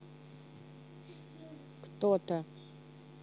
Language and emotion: Russian, neutral